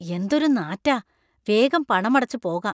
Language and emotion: Malayalam, disgusted